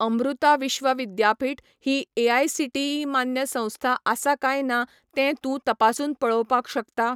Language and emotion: Goan Konkani, neutral